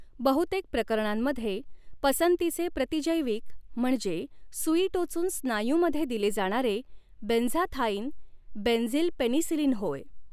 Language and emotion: Marathi, neutral